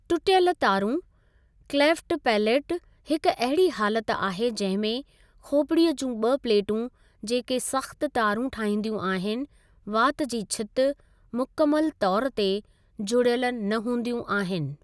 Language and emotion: Sindhi, neutral